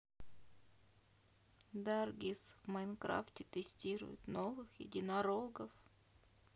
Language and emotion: Russian, sad